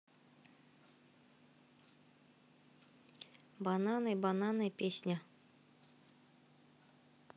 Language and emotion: Russian, neutral